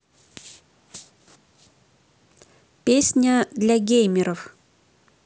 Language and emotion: Russian, neutral